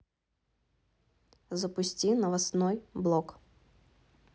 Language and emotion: Russian, neutral